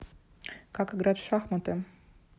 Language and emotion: Russian, neutral